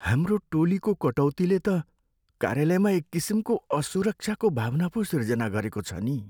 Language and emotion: Nepali, sad